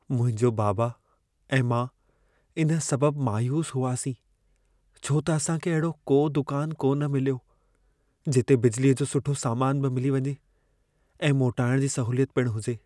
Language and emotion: Sindhi, sad